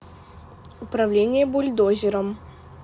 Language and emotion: Russian, neutral